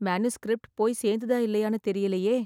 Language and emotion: Tamil, fearful